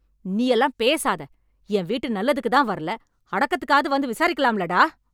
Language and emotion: Tamil, angry